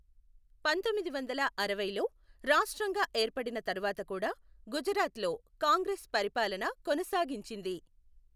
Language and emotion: Telugu, neutral